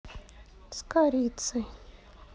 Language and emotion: Russian, sad